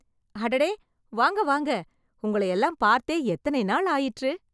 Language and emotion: Tamil, happy